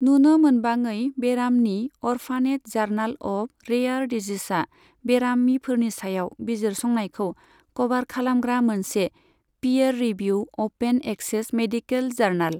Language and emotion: Bodo, neutral